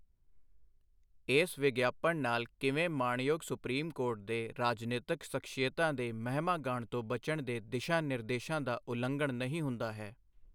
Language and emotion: Punjabi, neutral